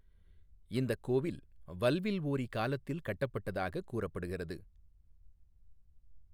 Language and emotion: Tamil, neutral